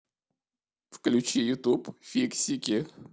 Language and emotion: Russian, sad